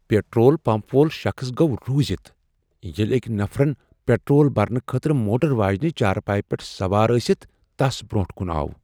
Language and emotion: Kashmiri, surprised